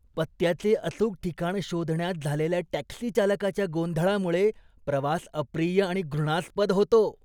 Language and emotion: Marathi, disgusted